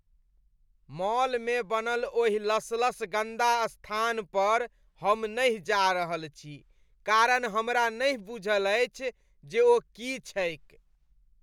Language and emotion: Maithili, disgusted